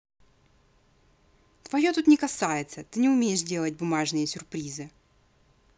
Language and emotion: Russian, angry